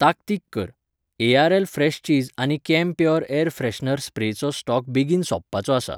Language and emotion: Goan Konkani, neutral